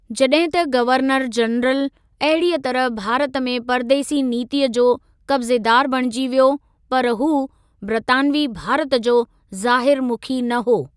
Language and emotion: Sindhi, neutral